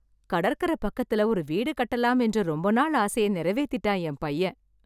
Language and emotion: Tamil, happy